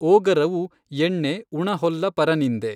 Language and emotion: Kannada, neutral